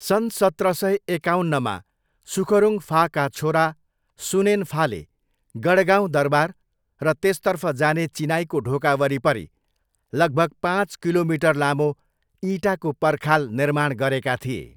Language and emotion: Nepali, neutral